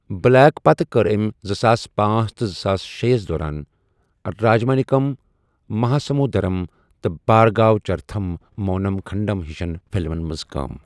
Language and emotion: Kashmiri, neutral